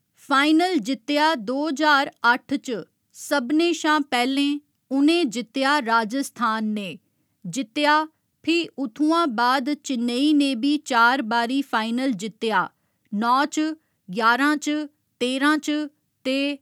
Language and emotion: Dogri, neutral